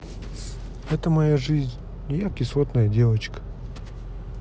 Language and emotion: Russian, neutral